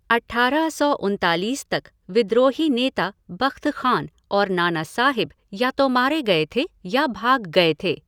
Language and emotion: Hindi, neutral